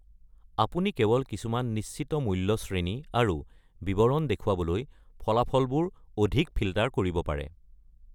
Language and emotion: Assamese, neutral